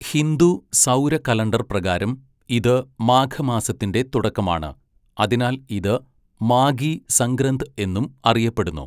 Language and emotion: Malayalam, neutral